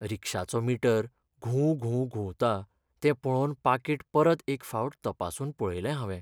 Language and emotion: Goan Konkani, sad